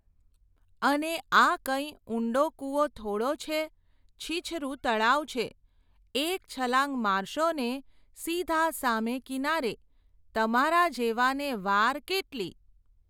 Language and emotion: Gujarati, neutral